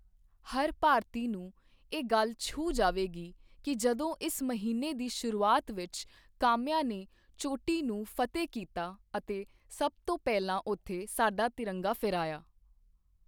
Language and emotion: Punjabi, neutral